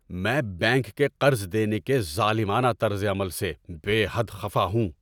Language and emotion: Urdu, angry